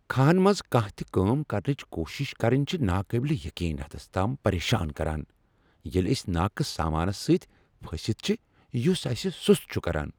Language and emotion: Kashmiri, angry